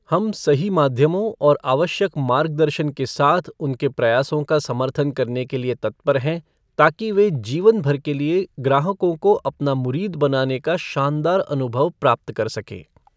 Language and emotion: Hindi, neutral